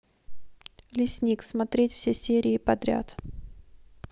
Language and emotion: Russian, neutral